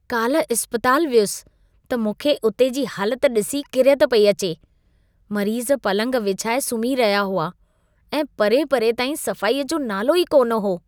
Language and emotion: Sindhi, disgusted